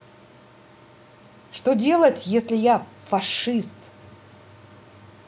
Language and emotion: Russian, angry